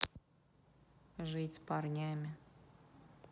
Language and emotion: Russian, neutral